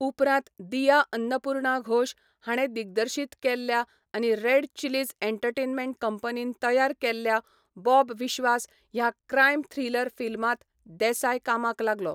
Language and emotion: Goan Konkani, neutral